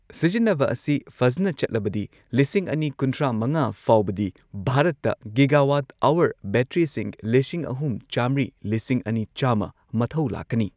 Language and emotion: Manipuri, neutral